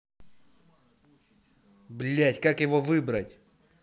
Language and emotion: Russian, angry